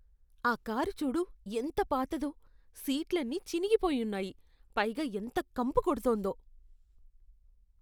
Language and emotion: Telugu, disgusted